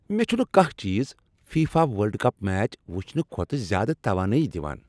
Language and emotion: Kashmiri, happy